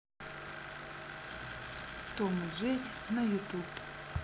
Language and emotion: Russian, neutral